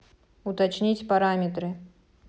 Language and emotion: Russian, neutral